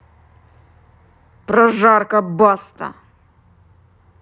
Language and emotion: Russian, angry